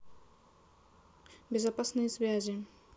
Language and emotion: Russian, neutral